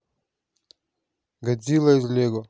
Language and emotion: Russian, neutral